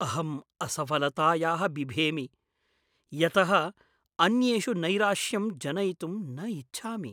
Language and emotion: Sanskrit, fearful